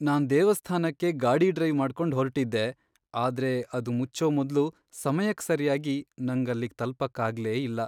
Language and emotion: Kannada, sad